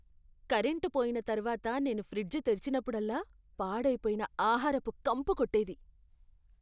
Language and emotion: Telugu, disgusted